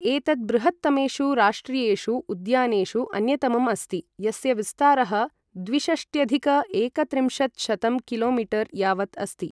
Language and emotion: Sanskrit, neutral